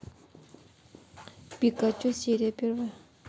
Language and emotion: Russian, neutral